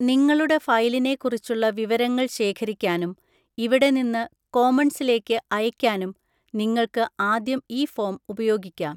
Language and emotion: Malayalam, neutral